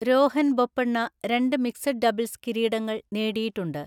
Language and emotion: Malayalam, neutral